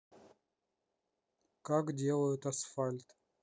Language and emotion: Russian, neutral